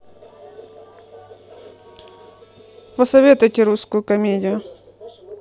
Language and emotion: Russian, neutral